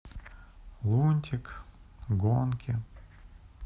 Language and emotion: Russian, sad